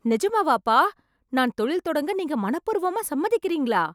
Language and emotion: Tamil, surprised